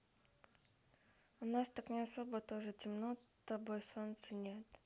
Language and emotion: Russian, neutral